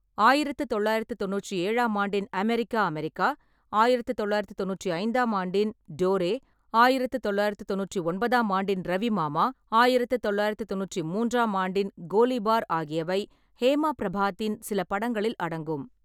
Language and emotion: Tamil, neutral